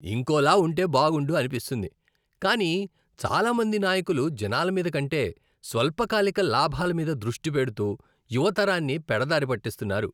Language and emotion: Telugu, disgusted